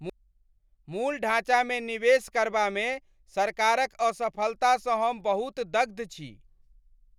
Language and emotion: Maithili, angry